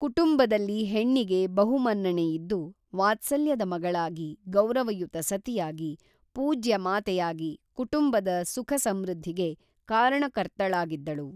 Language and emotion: Kannada, neutral